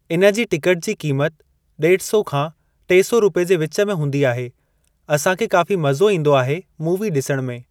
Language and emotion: Sindhi, neutral